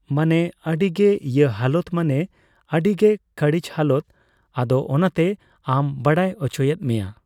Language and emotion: Santali, neutral